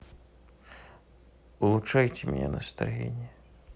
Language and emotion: Russian, sad